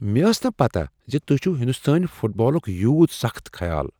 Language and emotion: Kashmiri, surprised